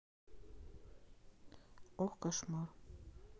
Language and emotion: Russian, neutral